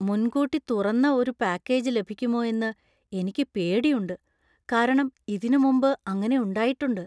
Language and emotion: Malayalam, fearful